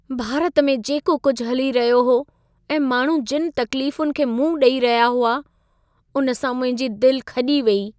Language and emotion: Sindhi, sad